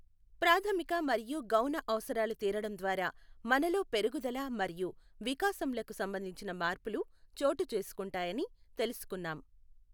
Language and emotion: Telugu, neutral